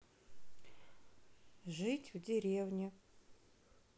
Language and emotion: Russian, neutral